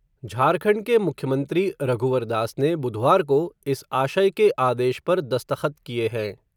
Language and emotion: Hindi, neutral